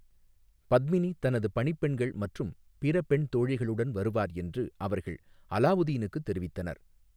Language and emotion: Tamil, neutral